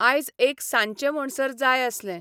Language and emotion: Goan Konkani, neutral